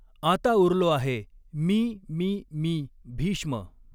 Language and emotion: Marathi, neutral